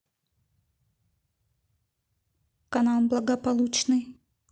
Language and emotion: Russian, neutral